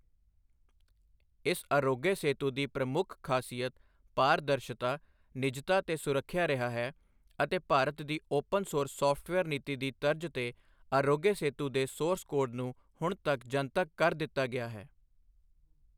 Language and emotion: Punjabi, neutral